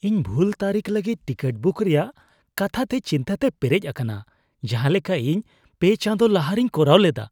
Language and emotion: Santali, fearful